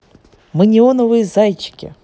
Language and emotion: Russian, positive